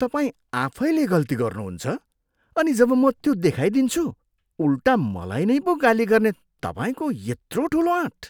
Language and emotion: Nepali, disgusted